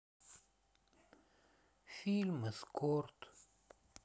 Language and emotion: Russian, sad